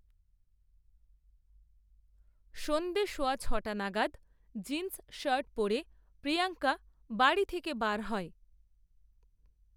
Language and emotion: Bengali, neutral